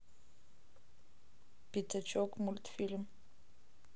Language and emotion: Russian, neutral